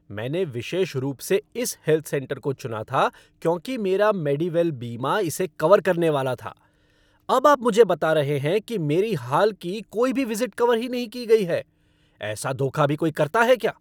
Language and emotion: Hindi, angry